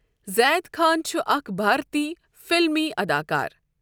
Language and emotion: Kashmiri, neutral